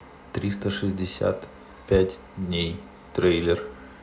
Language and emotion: Russian, neutral